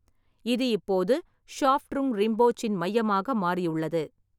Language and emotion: Tamil, neutral